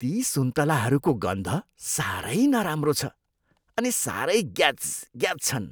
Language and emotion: Nepali, disgusted